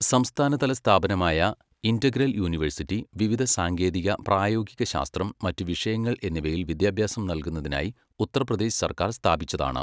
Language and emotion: Malayalam, neutral